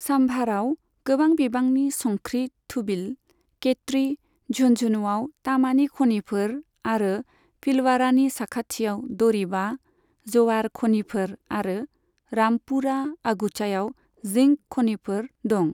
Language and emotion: Bodo, neutral